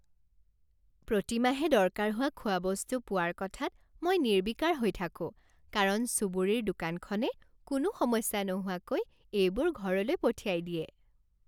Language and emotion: Assamese, happy